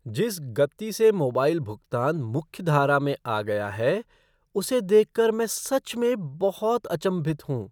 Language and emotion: Hindi, surprised